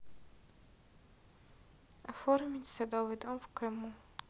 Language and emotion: Russian, neutral